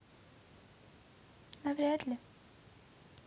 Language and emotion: Russian, neutral